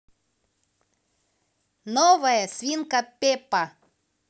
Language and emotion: Russian, positive